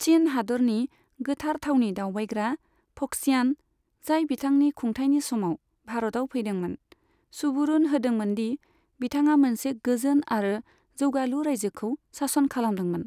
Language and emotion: Bodo, neutral